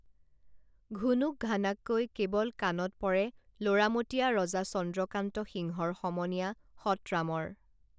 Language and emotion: Assamese, neutral